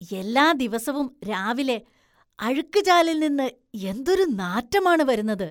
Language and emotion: Malayalam, disgusted